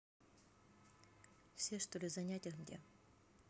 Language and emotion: Russian, neutral